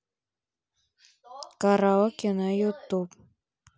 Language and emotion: Russian, neutral